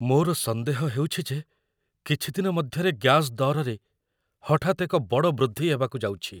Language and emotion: Odia, fearful